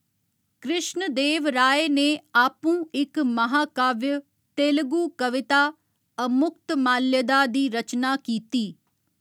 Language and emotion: Dogri, neutral